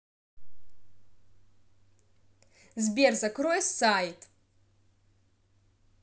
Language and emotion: Russian, angry